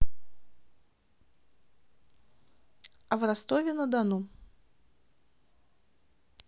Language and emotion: Russian, neutral